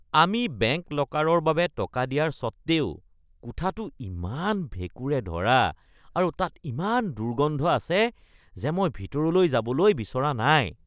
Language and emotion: Assamese, disgusted